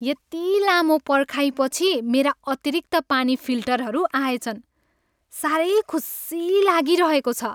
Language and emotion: Nepali, happy